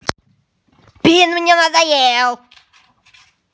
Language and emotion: Russian, angry